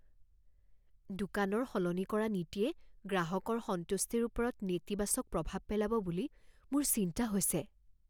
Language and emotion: Assamese, fearful